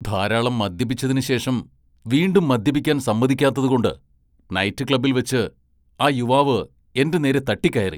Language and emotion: Malayalam, angry